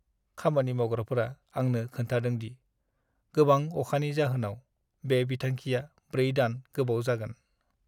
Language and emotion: Bodo, sad